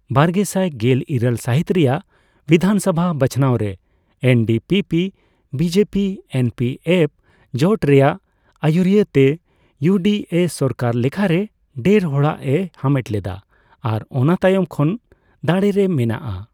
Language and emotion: Santali, neutral